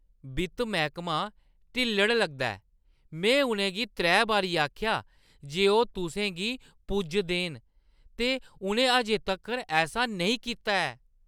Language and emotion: Dogri, disgusted